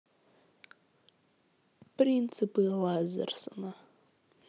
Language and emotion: Russian, neutral